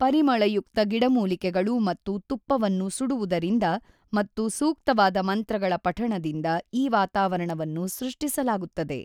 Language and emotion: Kannada, neutral